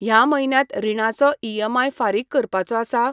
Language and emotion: Goan Konkani, neutral